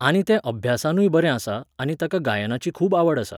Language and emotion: Goan Konkani, neutral